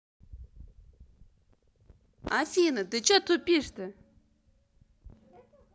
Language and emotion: Russian, angry